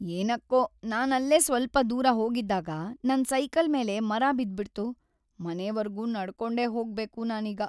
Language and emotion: Kannada, sad